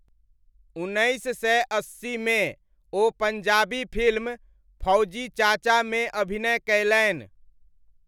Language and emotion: Maithili, neutral